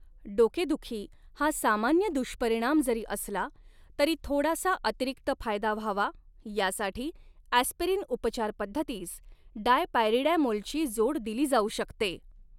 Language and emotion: Marathi, neutral